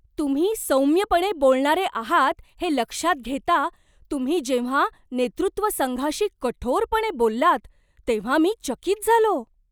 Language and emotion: Marathi, surprised